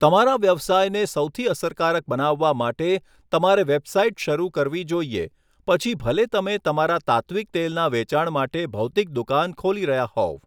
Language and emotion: Gujarati, neutral